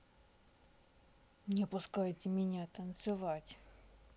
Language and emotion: Russian, sad